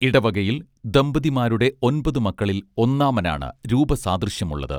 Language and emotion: Malayalam, neutral